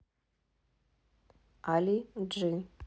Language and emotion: Russian, neutral